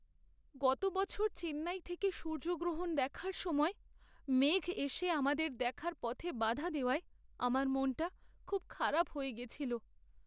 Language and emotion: Bengali, sad